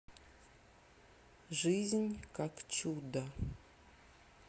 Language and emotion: Russian, neutral